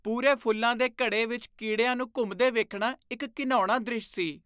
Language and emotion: Punjabi, disgusted